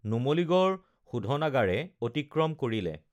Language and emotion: Assamese, neutral